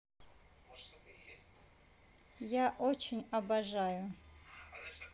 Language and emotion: Russian, neutral